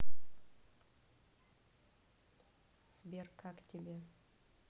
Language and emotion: Russian, neutral